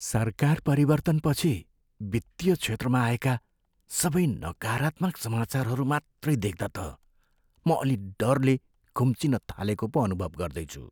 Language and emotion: Nepali, fearful